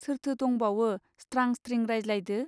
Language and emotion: Bodo, neutral